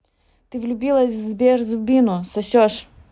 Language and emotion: Russian, neutral